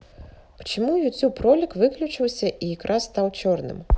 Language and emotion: Russian, neutral